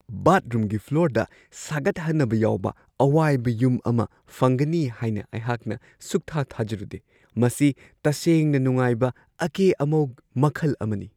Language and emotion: Manipuri, surprised